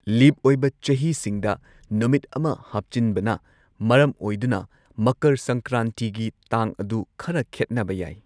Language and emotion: Manipuri, neutral